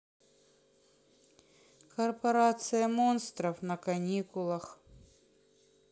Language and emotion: Russian, sad